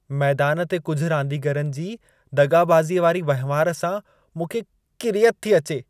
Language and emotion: Sindhi, disgusted